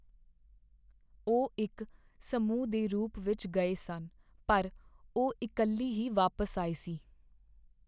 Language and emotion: Punjabi, sad